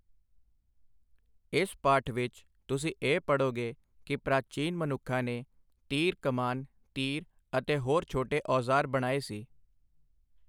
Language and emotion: Punjabi, neutral